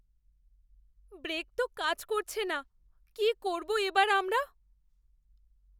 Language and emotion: Bengali, fearful